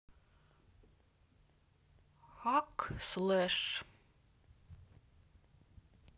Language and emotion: Russian, neutral